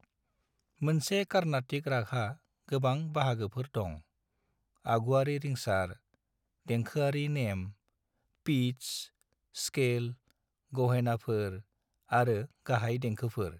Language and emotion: Bodo, neutral